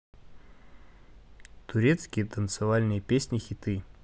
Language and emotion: Russian, neutral